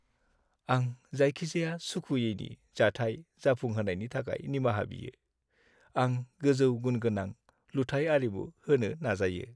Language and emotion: Bodo, sad